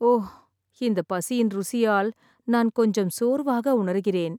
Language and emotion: Tamil, sad